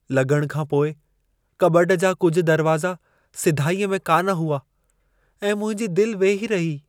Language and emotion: Sindhi, sad